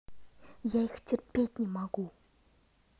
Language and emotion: Russian, angry